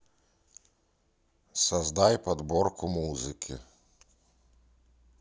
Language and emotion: Russian, neutral